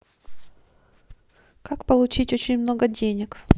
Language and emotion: Russian, neutral